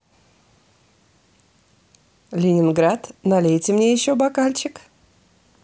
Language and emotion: Russian, positive